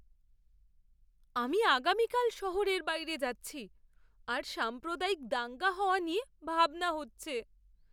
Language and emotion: Bengali, fearful